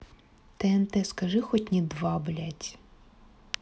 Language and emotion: Russian, angry